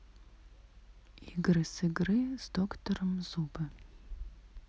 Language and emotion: Russian, neutral